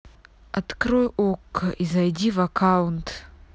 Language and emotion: Russian, angry